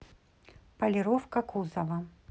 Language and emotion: Russian, neutral